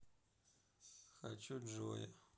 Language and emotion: Russian, neutral